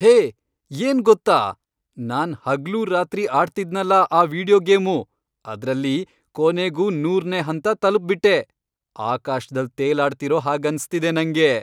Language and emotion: Kannada, happy